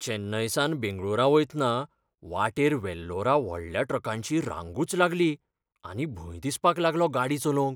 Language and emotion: Goan Konkani, fearful